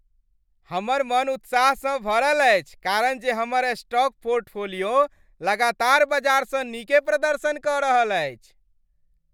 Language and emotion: Maithili, happy